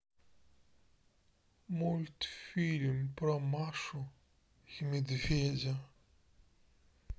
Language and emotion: Russian, sad